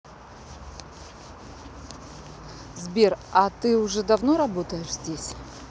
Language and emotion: Russian, neutral